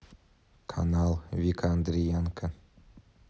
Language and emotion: Russian, neutral